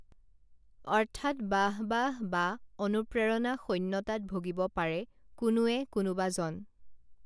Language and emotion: Assamese, neutral